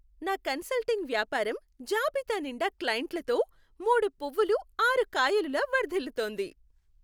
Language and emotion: Telugu, happy